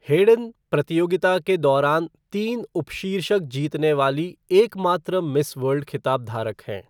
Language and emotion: Hindi, neutral